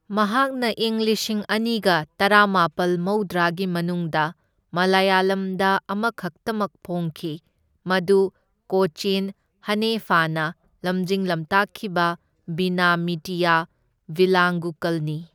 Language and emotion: Manipuri, neutral